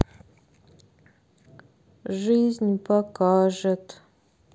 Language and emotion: Russian, sad